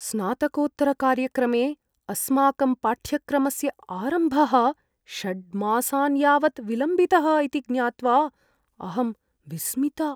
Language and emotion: Sanskrit, fearful